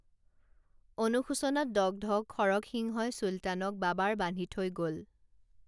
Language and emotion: Assamese, neutral